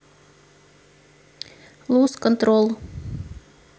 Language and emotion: Russian, neutral